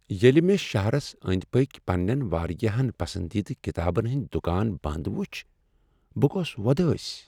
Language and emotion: Kashmiri, sad